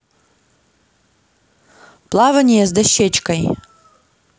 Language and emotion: Russian, neutral